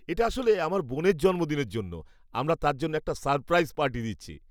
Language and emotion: Bengali, happy